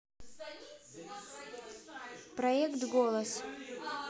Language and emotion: Russian, neutral